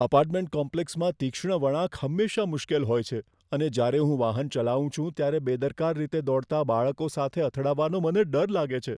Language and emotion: Gujarati, fearful